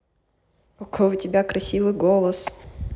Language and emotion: Russian, positive